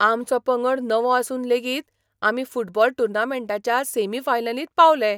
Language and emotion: Goan Konkani, surprised